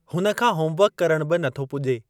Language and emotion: Sindhi, neutral